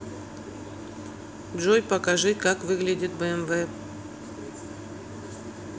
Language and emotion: Russian, neutral